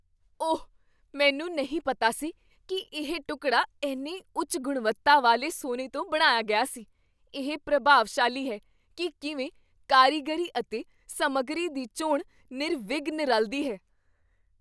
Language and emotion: Punjabi, surprised